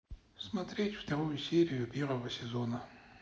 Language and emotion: Russian, neutral